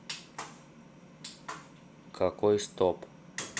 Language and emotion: Russian, neutral